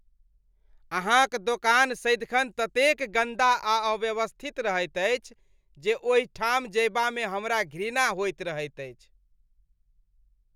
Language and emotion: Maithili, disgusted